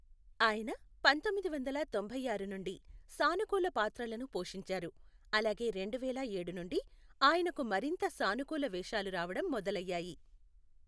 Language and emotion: Telugu, neutral